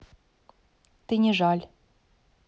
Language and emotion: Russian, neutral